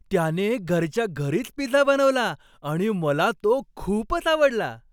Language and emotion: Marathi, happy